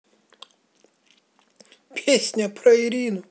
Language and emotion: Russian, positive